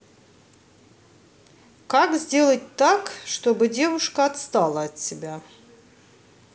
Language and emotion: Russian, neutral